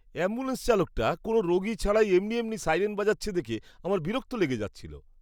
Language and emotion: Bengali, disgusted